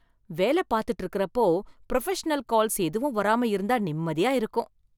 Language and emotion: Tamil, happy